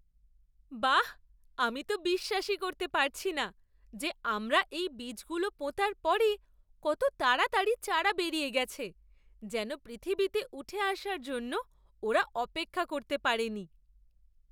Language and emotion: Bengali, surprised